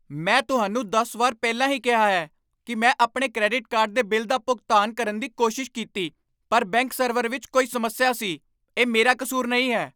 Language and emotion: Punjabi, angry